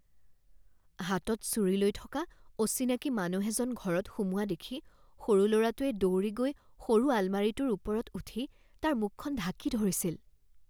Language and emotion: Assamese, fearful